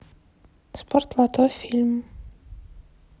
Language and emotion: Russian, neutral